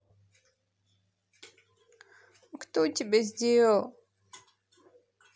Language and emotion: Russian, sad